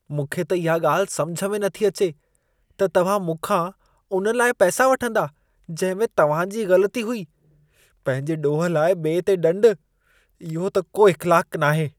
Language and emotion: Sindhi, disgusted